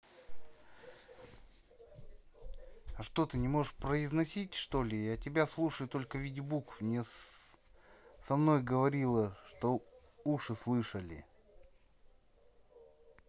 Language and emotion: Russian, neutral